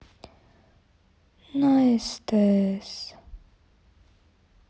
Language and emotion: Russian, sad